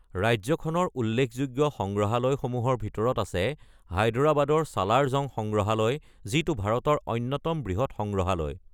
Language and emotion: Assamese, neutral